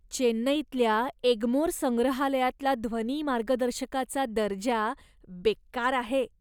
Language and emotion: Marathi, disgusted